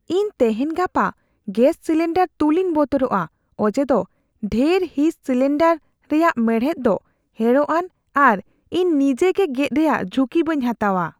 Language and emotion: Santali, fearful